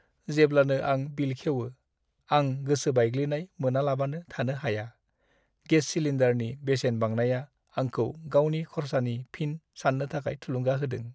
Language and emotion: Bodo, sad